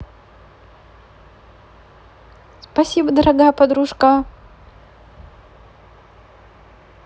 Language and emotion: Russian, positive